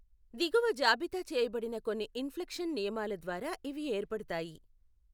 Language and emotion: Telugu, neutral